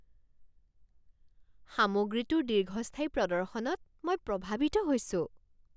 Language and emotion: Assamese, surprised